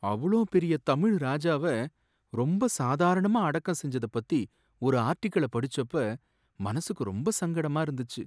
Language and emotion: Tamil, sad